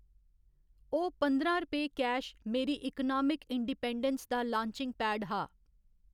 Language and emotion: Dogri, neutral